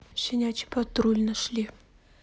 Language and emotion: Russian, neutral